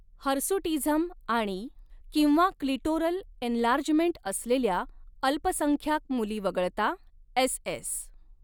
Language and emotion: Marathi, neutral